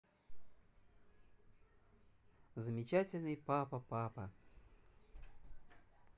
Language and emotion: Russian, positive